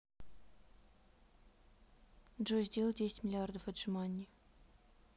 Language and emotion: Russian, neutral